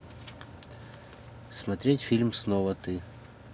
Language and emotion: Russian, neutral